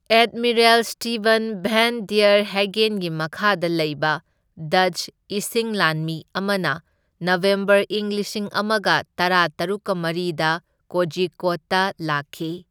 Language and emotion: Manipuri, neutral